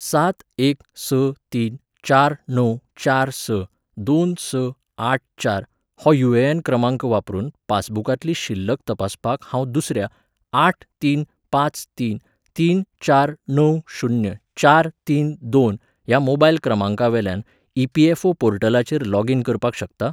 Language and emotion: Goan Konkani, neutral